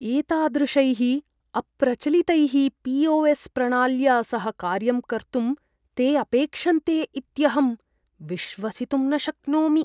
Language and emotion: Sanskrit, disgusted